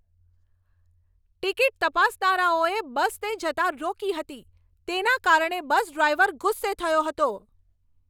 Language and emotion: Gujarati, angry